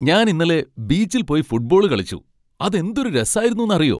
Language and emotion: Malayalam, happy